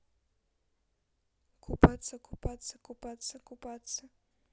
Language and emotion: Russian, neutral